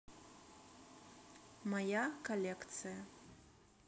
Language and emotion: Russian, neutral